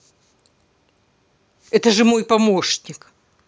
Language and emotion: Russian, angry